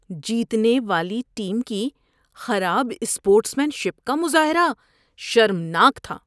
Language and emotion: Urdu, disgusted